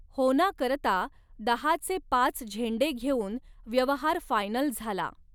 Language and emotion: Marathi, neutral